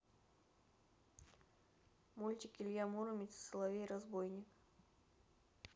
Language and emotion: Russian, neutral